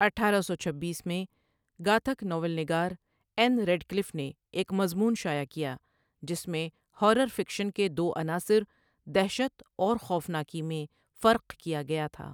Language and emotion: Urdu, neutral